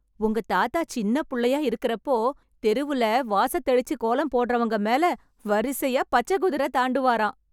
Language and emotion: Tamil, happy